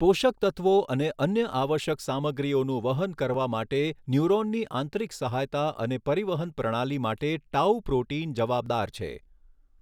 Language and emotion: Gujarati, neutral